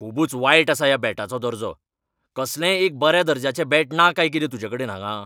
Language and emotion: Goan Konkani, angry